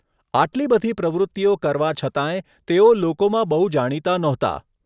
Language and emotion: Gujarati, neutral